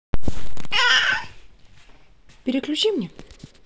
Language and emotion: Russian, neutral